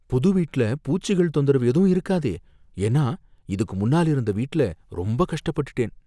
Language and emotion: Tamil, fearful